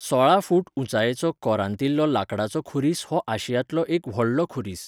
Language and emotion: Goan Konkani, neutral